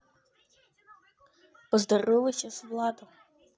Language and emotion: Russian, neutral